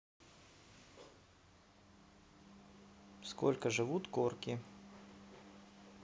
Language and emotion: Russian, neutral